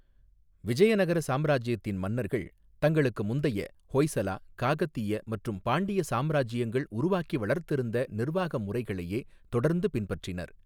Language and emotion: Tamil, neutral